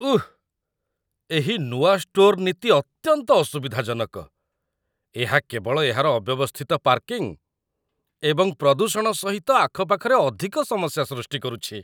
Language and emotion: Odia, disgusted